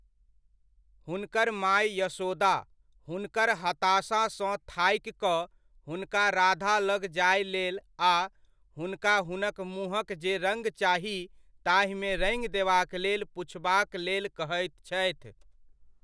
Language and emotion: Maithili, neutral